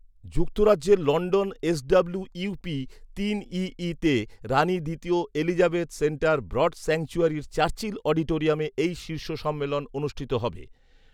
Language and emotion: Bengali, neutral